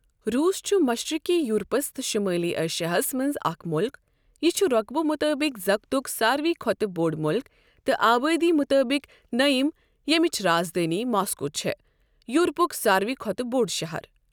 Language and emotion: Kashmiri, neutral